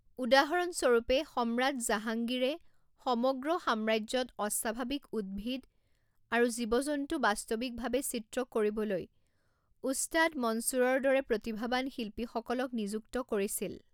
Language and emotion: Assamese, neutral